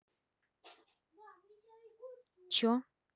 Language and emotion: Russian, neutral